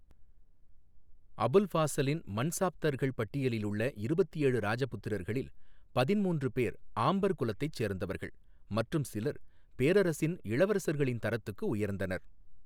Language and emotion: Tamil, neutral